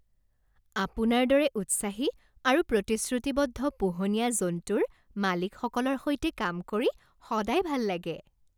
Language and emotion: Assamese, happy